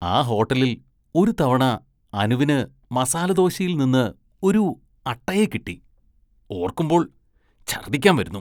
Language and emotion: Malayalam, disgusted